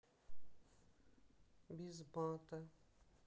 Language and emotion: Russian, sad